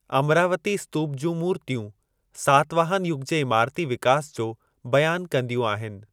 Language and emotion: Sindhi, neutral